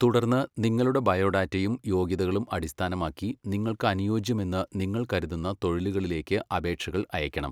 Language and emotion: Malayalam, neutral